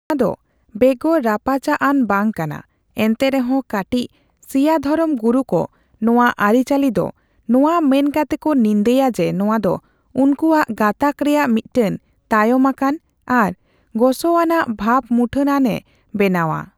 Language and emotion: Santali, neutral